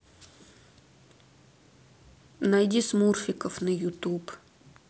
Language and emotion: Russian, neutral